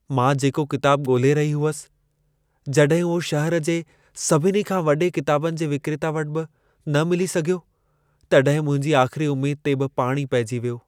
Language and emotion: Sindhi, sad